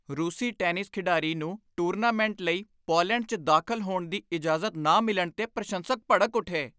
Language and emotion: Punjabi, angry